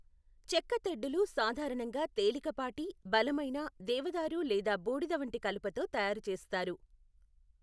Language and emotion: Telugu, neutral